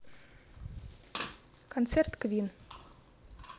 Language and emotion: Russian, neutral